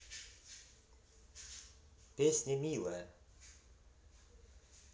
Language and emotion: Russian, positive